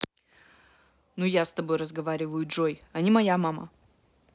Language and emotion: Russian, angry